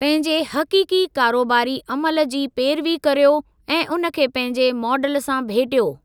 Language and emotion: Sindhi, neutral